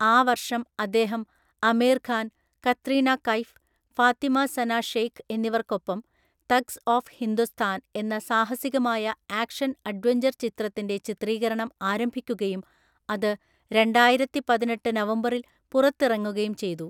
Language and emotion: Malayalam, neutral